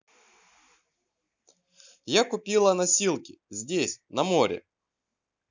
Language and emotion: Russian, positive